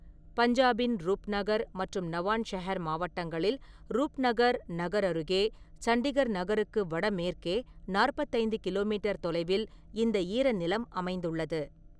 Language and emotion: Tamil, neutral